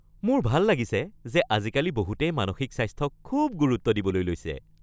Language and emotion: Assamese, happy